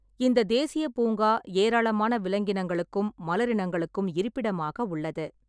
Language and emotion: Tamil, neutral